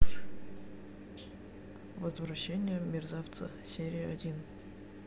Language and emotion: Russian, neutral